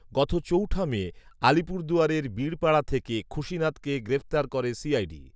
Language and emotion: Bengali, neutral